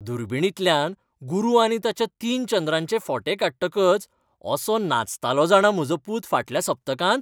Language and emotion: Goan Konkani, happy